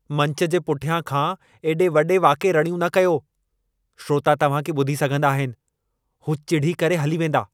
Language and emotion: Sindhi, angry